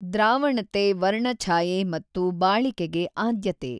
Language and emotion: Kannada, neutral